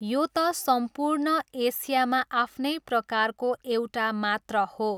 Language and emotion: Nepali, neutral